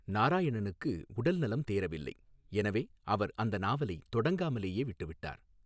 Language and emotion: Tamil, neutral